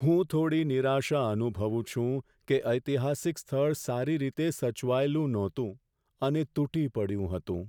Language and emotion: Gujarati, sad